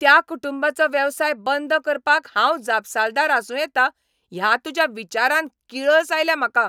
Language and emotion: Goan Konkani, angry